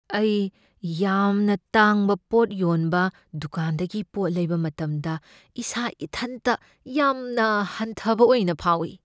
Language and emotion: Manipuri, fearful